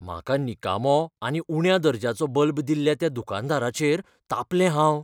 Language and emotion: Goan Konkani, fearful